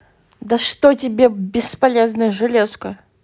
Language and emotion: Russian, angry